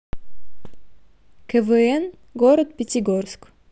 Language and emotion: Russian, neutral